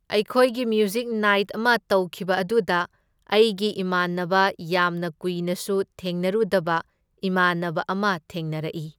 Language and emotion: Manipuri, neutral